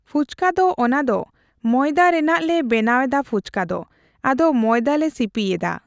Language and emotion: Santali, neutral